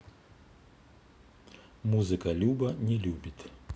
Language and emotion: Russian, neutral